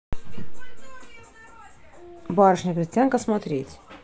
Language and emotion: Russian, neutral